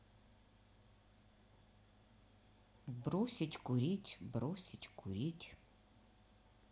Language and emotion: Russian, neutral